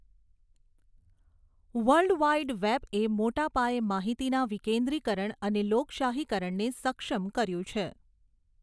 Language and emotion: Gujarati, neutral